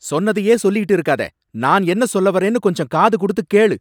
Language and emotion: Tamil, angry